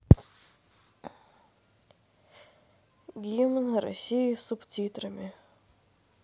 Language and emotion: Russian, neutral